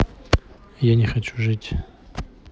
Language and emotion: Russian, neutral